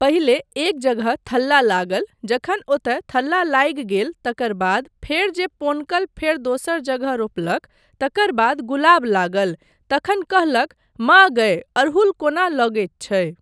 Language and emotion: Maithili, neutral